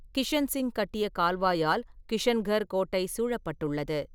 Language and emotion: Tamil, neutral